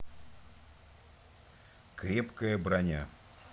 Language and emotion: Russian, neutral